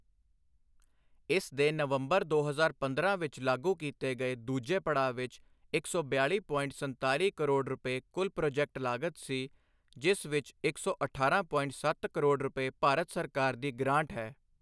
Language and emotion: Punjabi, neutral